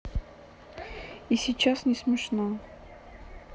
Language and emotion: Russian, sad